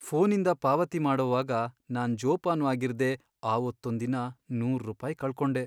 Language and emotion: Kannada, sad